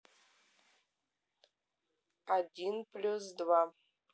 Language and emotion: Russian, neutral